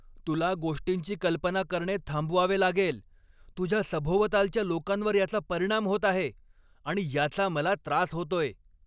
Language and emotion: Marathi, angry